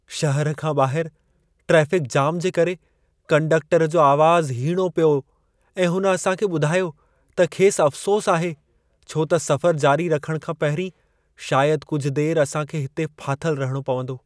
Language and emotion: Sindhi, sad